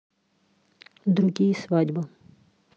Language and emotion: Russian, neutral